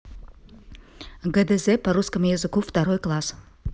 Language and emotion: Russian, neutral